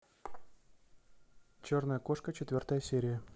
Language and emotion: Russian, neutral